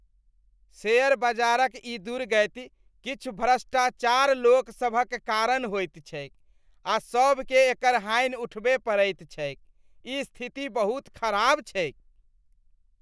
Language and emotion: Maithili, disgusted